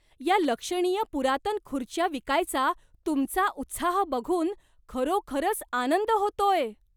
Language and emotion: Marathi, surprised